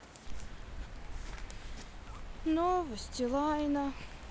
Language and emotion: Russian, sad